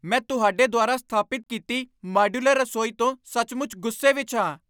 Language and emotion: Punjabi, angry